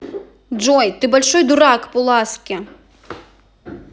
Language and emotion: Russian, angry